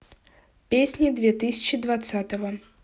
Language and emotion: Russian, neutral